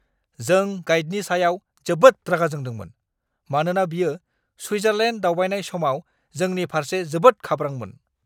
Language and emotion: Bodo, angry